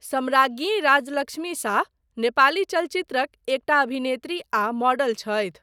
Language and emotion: Maithili, neutral